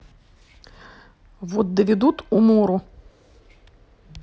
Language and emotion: Russian, neutral